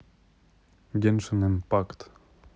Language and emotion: Russian, neutral